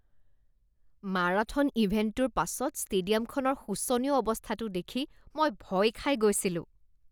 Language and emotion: Assamese, disgusted